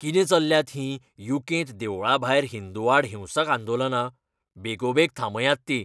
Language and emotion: Goan Konkani, angry